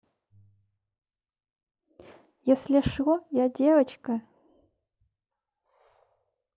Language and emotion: Russian, neutral